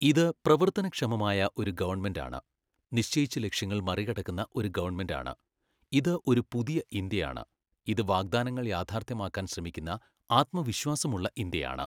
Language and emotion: Malayalam, neutral